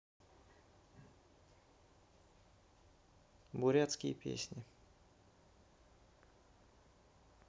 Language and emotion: Russian, neutral